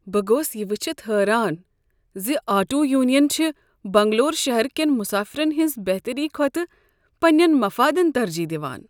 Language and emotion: Kashmiri, sad